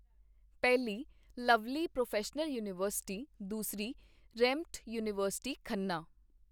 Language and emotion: Punjabi, neutral